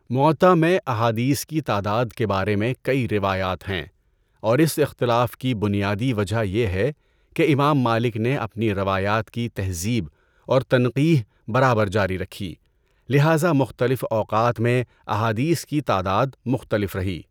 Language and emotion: Urdu, neutral